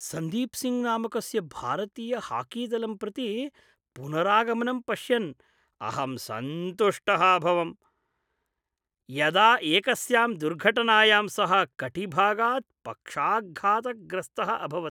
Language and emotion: Sanskrit, happy